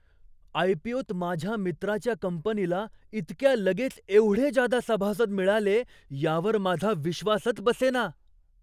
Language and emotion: Marathi, surprised